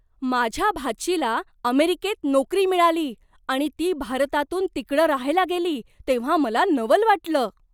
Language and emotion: Marathi, surprised